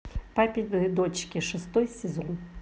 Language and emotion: Russian, neutral